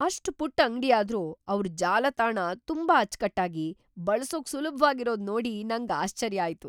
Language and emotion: Kannada, surprised